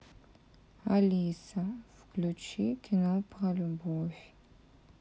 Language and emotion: Russian, sad